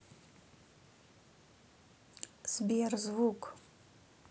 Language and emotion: Russian, neutral